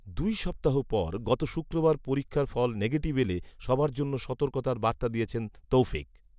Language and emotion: Bengali, neutral